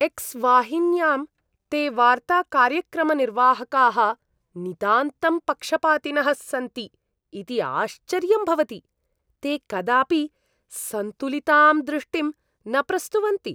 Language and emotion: Sanskrit, disgusted